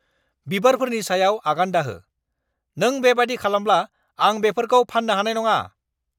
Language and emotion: Bodo, angry